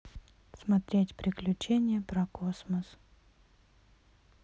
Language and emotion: Russian, neutral